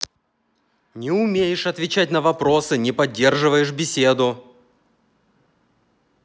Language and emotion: Russian, angry